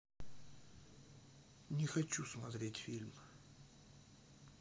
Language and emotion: Russian, sad